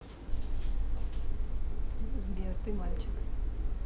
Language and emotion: Russian, neutral